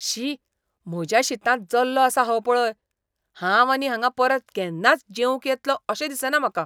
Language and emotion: Goan Konkani, disgusted